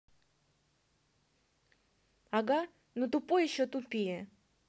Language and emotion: Russian, angry